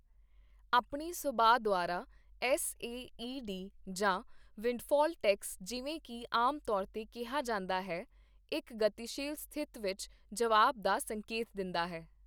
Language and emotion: Punjabi, neutral